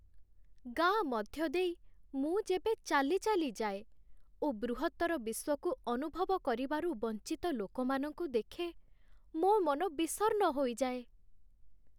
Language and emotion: Odia, sad